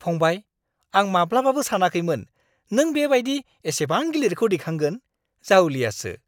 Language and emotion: Bodo, surprised